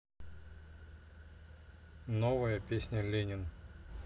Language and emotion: Russian, neutral